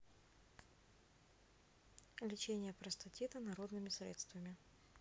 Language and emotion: Russian, neutral